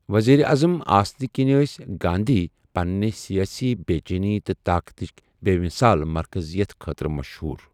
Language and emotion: Kashmiri, neutral